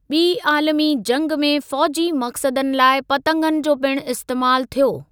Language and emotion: Sindhi, neutral